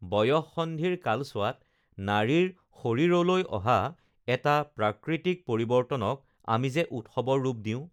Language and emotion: Assamese, neutral